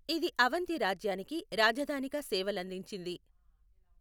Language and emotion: Telugu, neutral